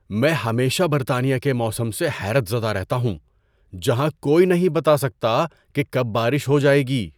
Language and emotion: Urdu, surprised